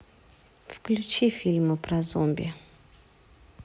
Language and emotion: Russian, neutral